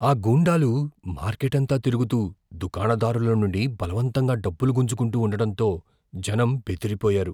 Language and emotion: Telugu, fearful